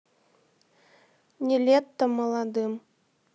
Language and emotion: Russian, neutral